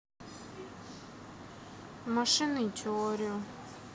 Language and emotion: Russian, sad